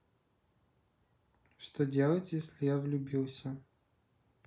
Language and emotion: Russian, neutral